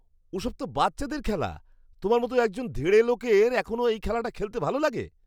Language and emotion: Bengali, disgusted